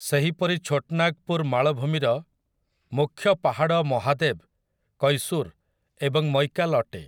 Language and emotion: Odia, neutral